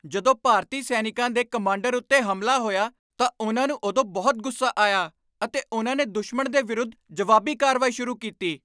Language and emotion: Punjabi, angry